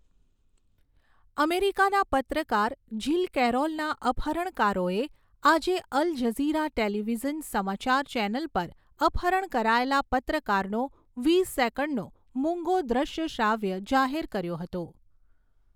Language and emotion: Gujarati, neutral